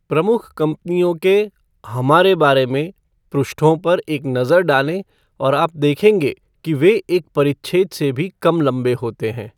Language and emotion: Hindi, neutral